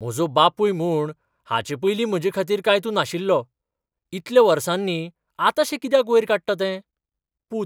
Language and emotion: Goan Konkani, surprised